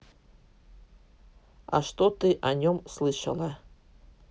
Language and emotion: Russian, neutral